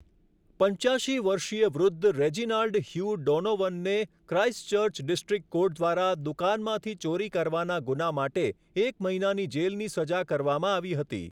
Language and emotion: Gujarati, neutral